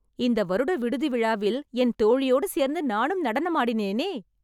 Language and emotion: Tamil, happy